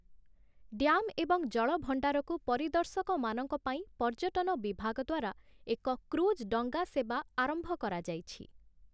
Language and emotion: Odia, neutral